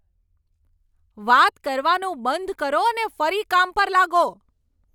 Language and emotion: Gujarati, angry